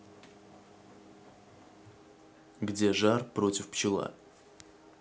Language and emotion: Russian, neutral